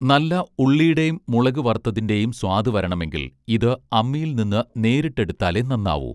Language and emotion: Malayalam, neutral